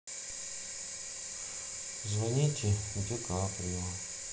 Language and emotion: Russian, sad